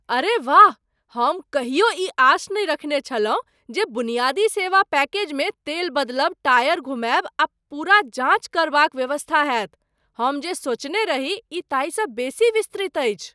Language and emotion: Maithili, surprised